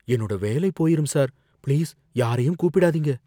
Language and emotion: Tamil, fearful